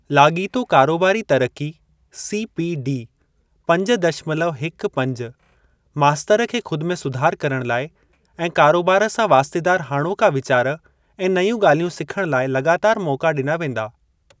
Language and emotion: Sindhi, neutral